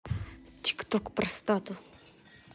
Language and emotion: Russian, angry